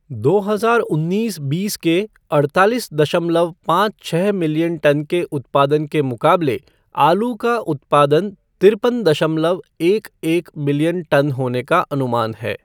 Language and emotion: Hindi, neutral